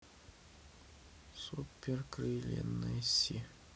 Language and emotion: Russian, sad